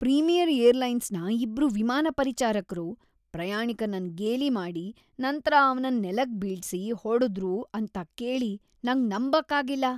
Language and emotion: Kannada, disgusted